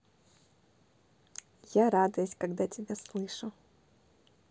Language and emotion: Russian, positive